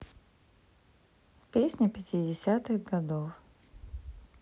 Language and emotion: Russian, neutral